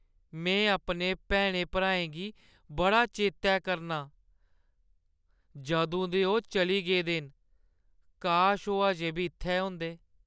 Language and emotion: Dogri, sad